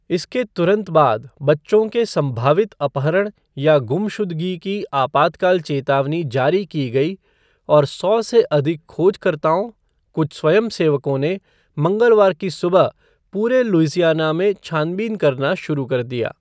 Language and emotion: Hindi, neutral